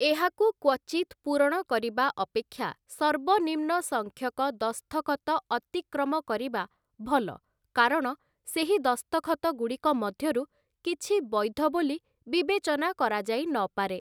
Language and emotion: Odia, neutral